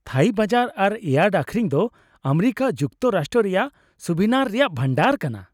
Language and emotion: Santali, happy